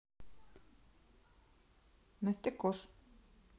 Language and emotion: Russian, neutral